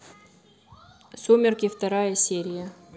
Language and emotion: Russian, neutral